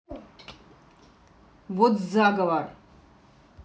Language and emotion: Russian, angry